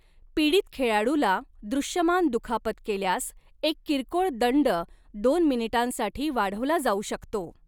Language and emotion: Marathi, neutral